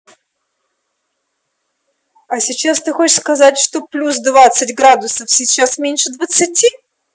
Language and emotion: Russian, neutral